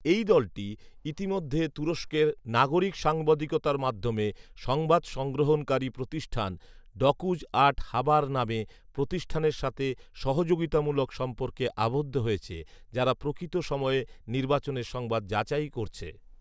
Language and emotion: Bengali, neutral